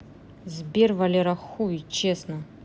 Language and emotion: Russian, angry